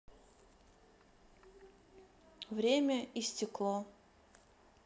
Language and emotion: Russian, neutral